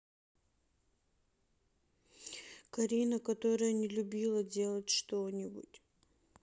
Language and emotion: Russian, sad